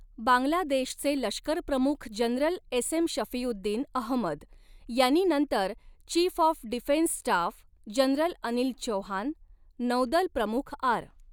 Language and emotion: Marathi, neutral